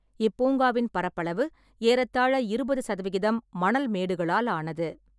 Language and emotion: Tamil, neutral